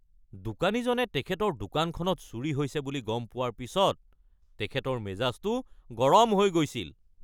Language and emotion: Assamese, angry